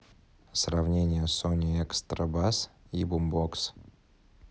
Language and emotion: Russian, neutral